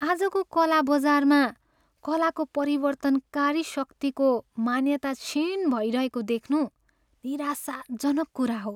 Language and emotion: Nepali, sad